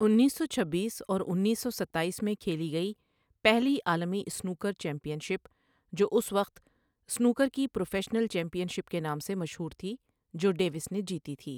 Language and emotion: Urdu, neutral